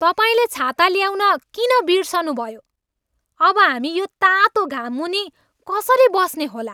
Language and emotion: Nepali, angry